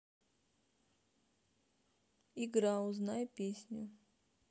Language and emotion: Russian, neutral